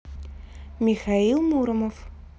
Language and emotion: Russian, neutral